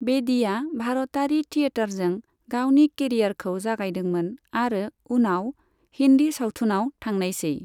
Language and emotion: Bodo, neutral